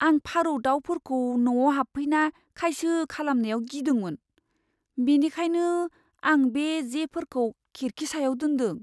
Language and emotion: Bodo, fearful